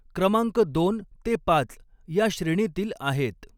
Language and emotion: Marathi, neutral